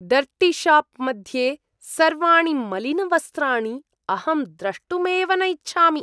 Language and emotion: Sanskrit, disgusted